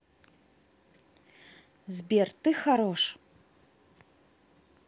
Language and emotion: Russian, positive